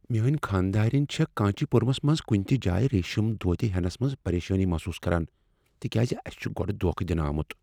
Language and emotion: Kashmiri, fearful